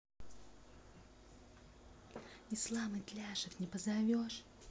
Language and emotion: Russian, positive